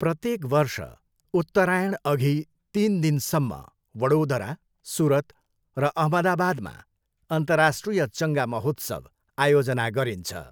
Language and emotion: Nepali, neutral